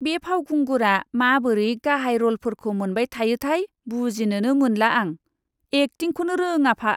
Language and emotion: Bodo, disgusted